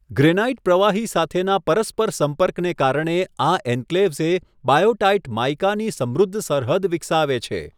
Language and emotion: Gujarati, neutral